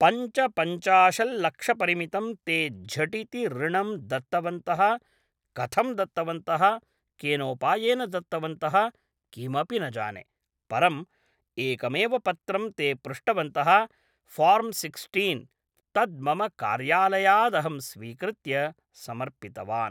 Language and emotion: Sanskrit, neutral